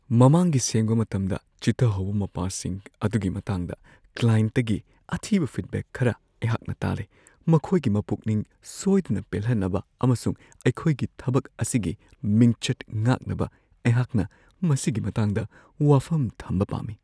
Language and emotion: Manipuri, fearful